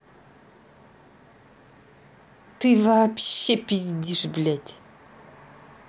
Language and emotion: Russian, angry